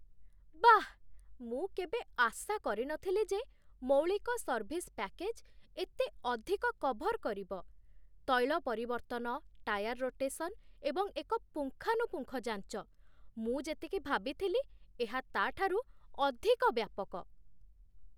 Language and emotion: Odia, surprised